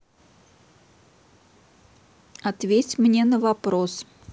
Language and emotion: Russian, neutral